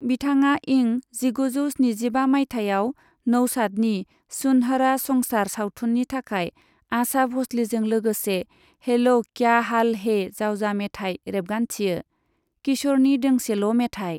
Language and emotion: Bodo, neutral